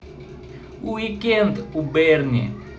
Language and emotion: Russian, positive